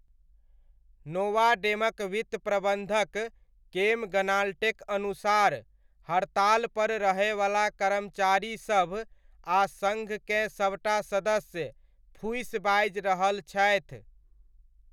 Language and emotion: Maithili, neutral